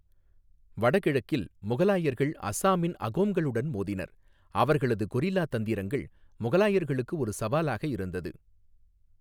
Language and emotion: Tamil, neutral